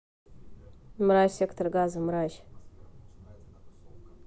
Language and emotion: Russian, neutral